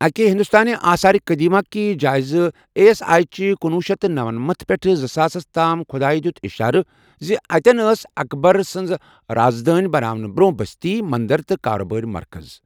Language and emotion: Kashmiri, neutral